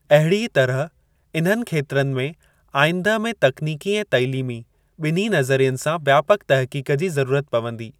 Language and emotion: Sindhi, neutral